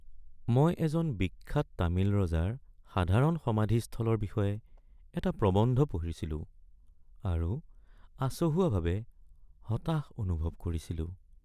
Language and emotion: Assamese, sad